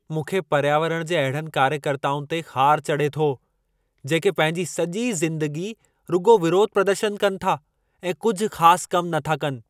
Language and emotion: Sindhi, angry